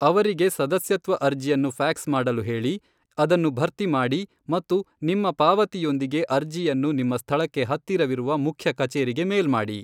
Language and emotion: Kannada, neutral